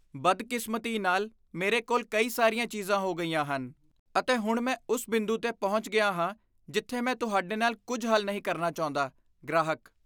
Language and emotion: Punjabi, disgusted